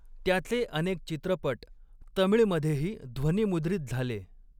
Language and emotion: Marathi, neutral